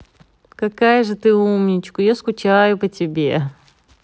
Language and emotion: Russian, positive